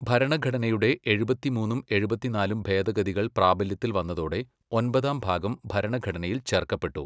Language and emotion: Malayalam, neutral